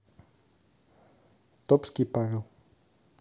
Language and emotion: Russian, neutral